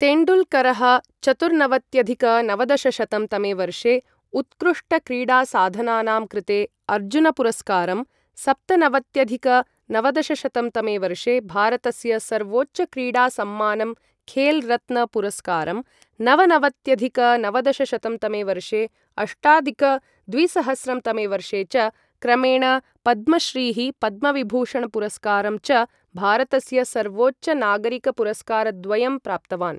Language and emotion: Sanskrit, neutral